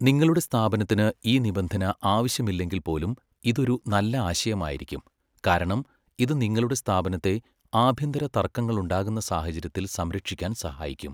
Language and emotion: Malayalam, neutral